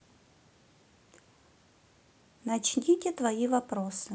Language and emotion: Russian, neutral